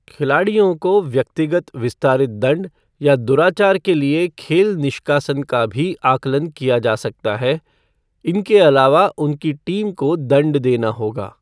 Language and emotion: Hindi, neutral